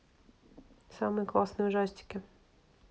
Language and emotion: Russian, neutral